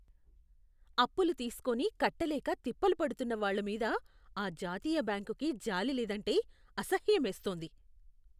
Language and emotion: Telugu, disgusted